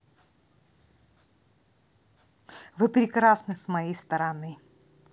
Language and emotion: Russian, positive